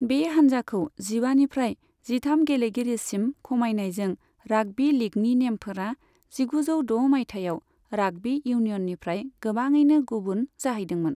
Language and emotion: Bodo, neutral